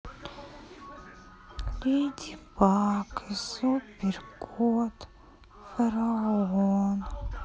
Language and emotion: Russian, sad